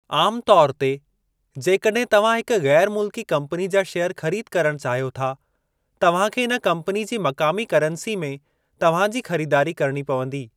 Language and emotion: Sindhi, neutral